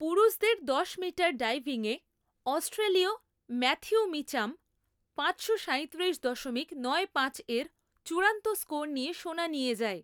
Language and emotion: Bengali, neutral